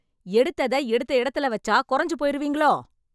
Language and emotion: Tamil, angry